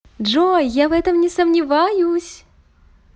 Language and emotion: Russian, positive